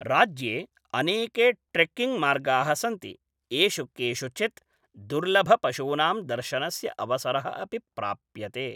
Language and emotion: Sanskrit, neutral